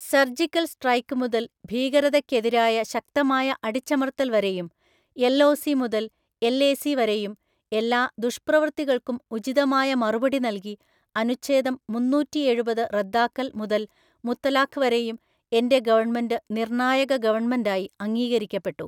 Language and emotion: Malayalam, neutral